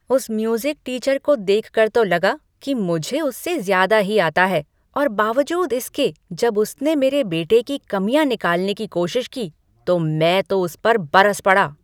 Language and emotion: Hindi, angry